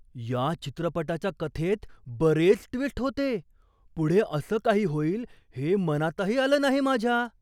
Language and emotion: Marathi, surprised